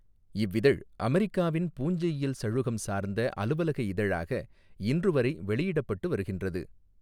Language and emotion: Tamil, neutral